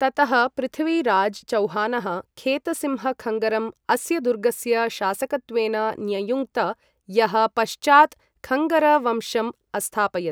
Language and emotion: Sanskrit, neutral